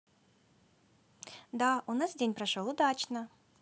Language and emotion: Russian, positive